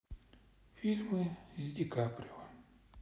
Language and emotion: Russian, sad